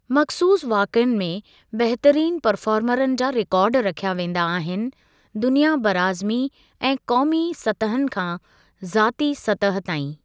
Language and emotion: Sindhi, neutral